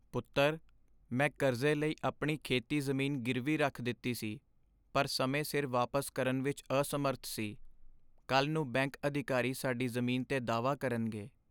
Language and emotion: Punjabi, sad